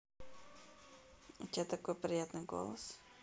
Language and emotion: Russian, positive